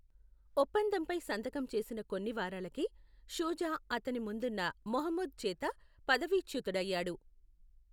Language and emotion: Telugu, neutral